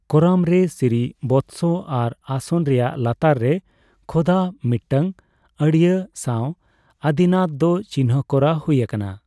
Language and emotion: Santali, neutral